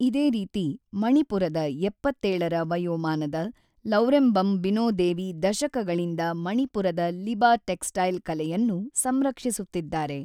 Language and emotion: Kannada, neutral